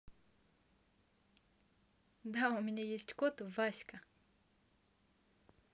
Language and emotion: Russian, positive